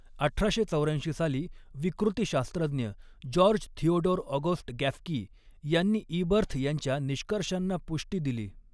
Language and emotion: Marathi, neutral